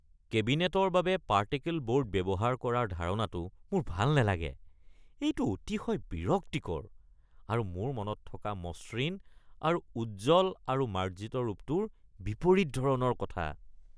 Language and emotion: Assamese, disgusted